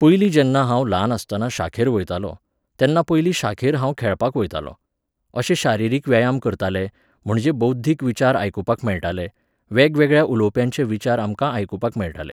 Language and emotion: Goan Konkani, neutral